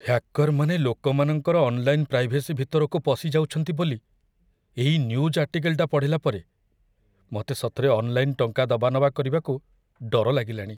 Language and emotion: Odia, fearful